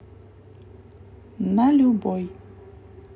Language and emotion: Russian, neutral